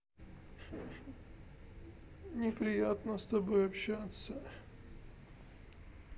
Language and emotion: Russian, sad